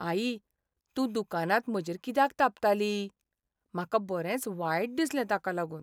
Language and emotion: Goan Konkani, sad